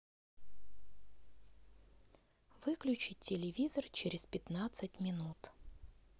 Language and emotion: Russian, neutral